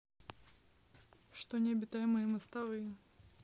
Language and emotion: Russian, neutral